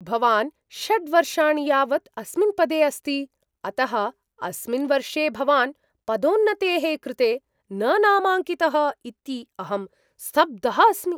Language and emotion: Sanskrit, surprised